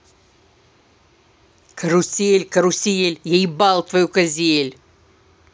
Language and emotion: Russian, angry